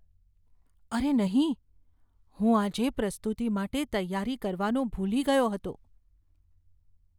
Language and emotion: Gujarati, fearful